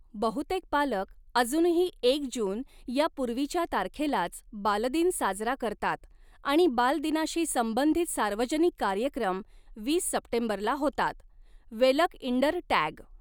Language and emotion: Marathi, neutral